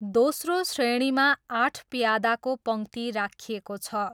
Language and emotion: Nepali, neutral